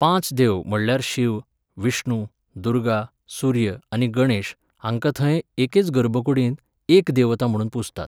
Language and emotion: Goan Konkani, neutral